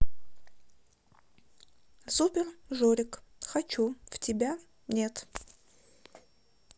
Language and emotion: Russian, neutral